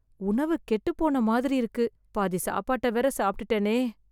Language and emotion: Tamil, fearful